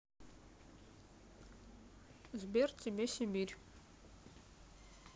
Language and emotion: Russian, neutral